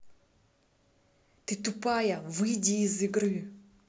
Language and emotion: Russian, angry